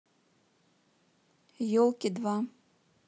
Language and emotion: Russian, neutral